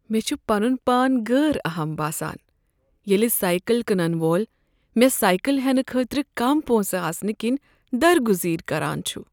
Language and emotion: Kashmiri, sad